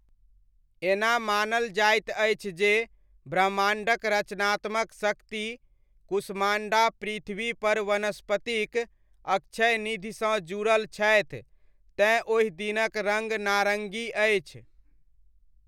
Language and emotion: Maithili, neutral